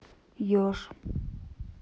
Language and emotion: Russian, neutral